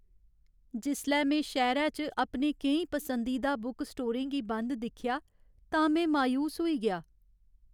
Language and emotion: Dogri, sad